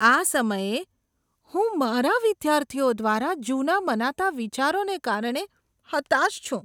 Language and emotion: Gujarati, disgusted